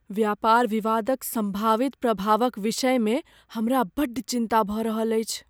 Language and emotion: Maithili, fearful